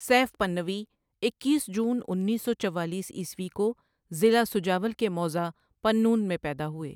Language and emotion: Urdu, neutral